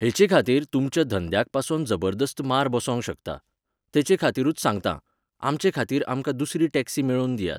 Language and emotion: Goan Konkani, neutral